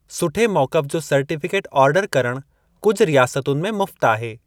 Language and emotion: Sindhi, neutral